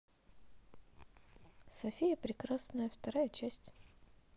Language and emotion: Russian, positive